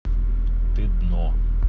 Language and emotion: Russian, neutral